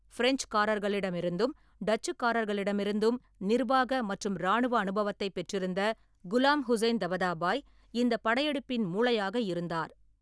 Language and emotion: Tamil, neutral